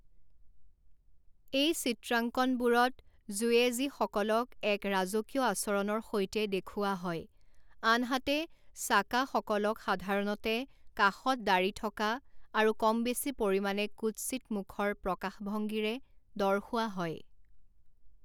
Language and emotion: Assamese, neutral